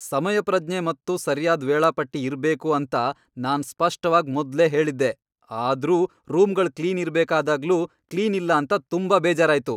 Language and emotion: Kannada, angry